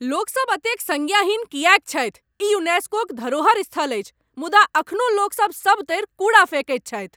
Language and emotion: Maithili, angry